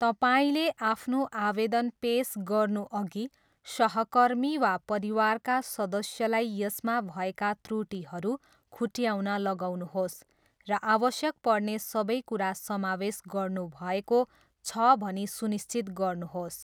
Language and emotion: Nepali, neutral